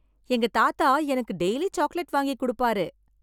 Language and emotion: Tamil, happy